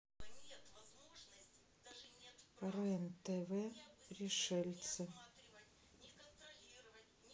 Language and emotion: Russian, neutral